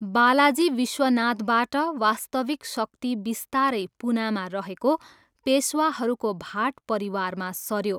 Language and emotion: Nepali, neutral